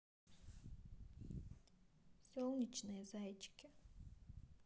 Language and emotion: Russian, neutral